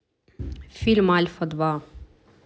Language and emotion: Russian, neutral